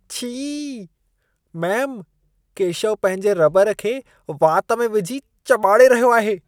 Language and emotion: Sindhi, disgusted